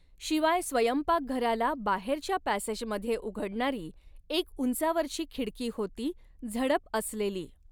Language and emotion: Marathi, neutral